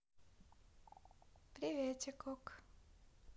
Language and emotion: Russian, neutral